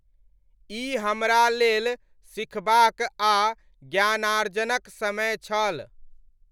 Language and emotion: Maithili, neutral